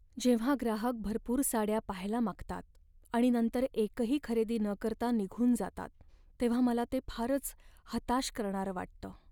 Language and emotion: Marathi, sad